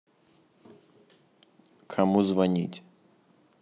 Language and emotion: Russian, neutral